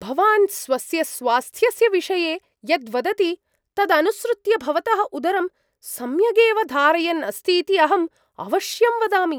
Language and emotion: Sanskrit, surprised